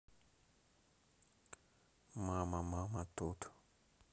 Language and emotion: Russian, neutral